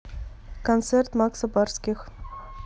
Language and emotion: Russian, neutral